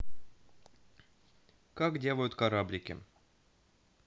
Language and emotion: Russian, neutral